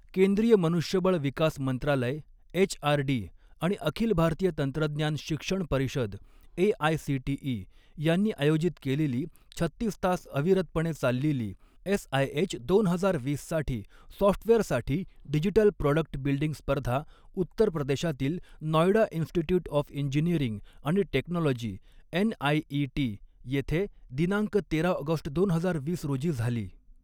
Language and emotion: Marathi, neutral